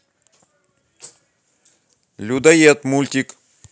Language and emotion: Russian, angry